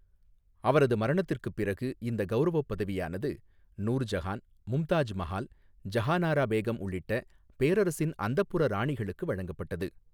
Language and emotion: Tamil, neutral